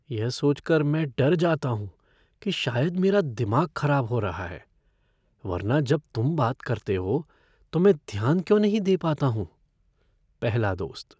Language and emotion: Hindi, fearful